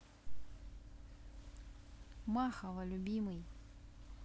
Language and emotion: Russian, neutral